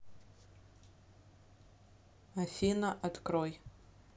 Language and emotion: Russian, neutral